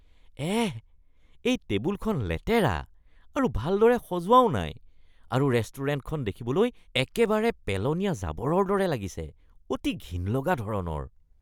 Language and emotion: Assamese, disgusted